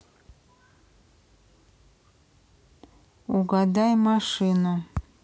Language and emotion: Russian, neutral